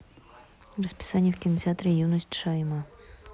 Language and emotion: Russian, neutral